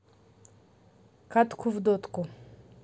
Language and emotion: Russian, neutral